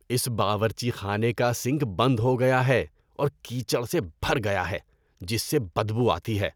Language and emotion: Urdu, disgusted